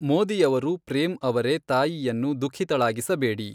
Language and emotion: Kannada, neutral